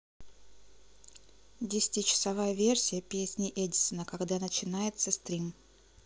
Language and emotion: Russian, neutral